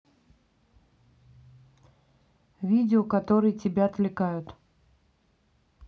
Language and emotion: Russian, neutral